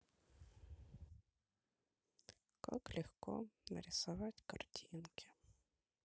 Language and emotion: Russian, sad